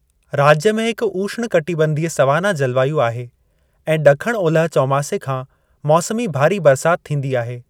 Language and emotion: Sindhi, neutral